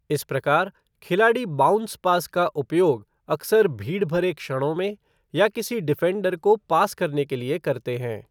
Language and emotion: Hindi, neutral